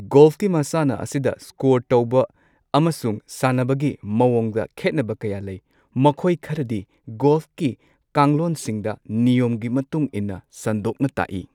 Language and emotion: Manipuri, neutral